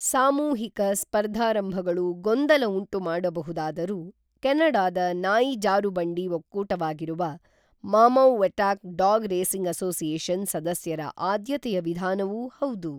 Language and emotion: Kannada, neutral